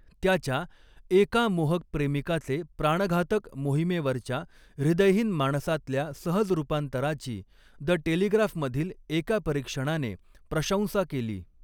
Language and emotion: Marathi, neutral